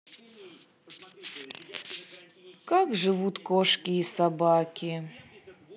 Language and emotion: Russian, sad